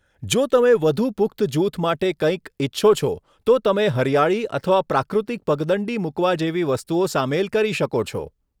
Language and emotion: Gujarati, neutral